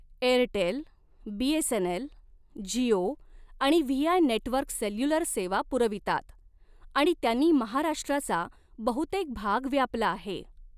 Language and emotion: Marathi, neutral